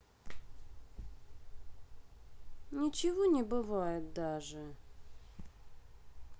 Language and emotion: Russian, sad